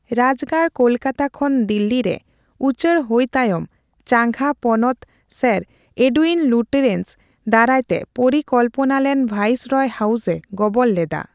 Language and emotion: Santali, neutral